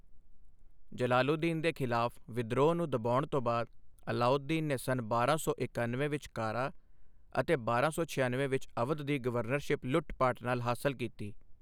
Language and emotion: Punjabi, neutral